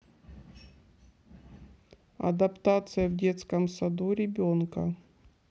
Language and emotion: Russian, neutral